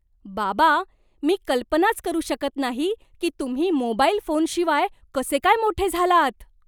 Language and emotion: Marathi, surprised